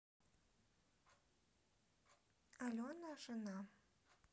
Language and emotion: Russian, neutral